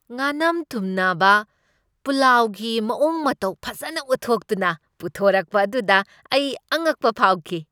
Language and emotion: Manipuri, happy